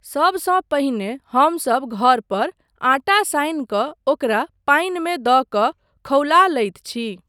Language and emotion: Maithili, neutral